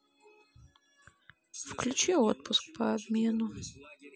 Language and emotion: Russian, sad